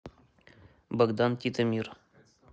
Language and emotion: Russian, neutral